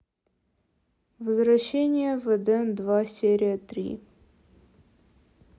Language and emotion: Russian, neutral